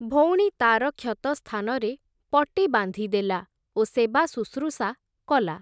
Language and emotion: Odia, neutral